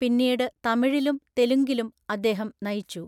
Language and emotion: Malayalam, neutral